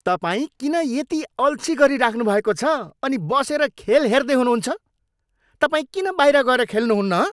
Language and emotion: Nepali, angry